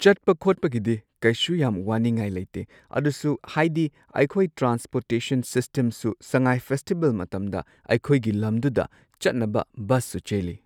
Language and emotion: Manipuri, neutral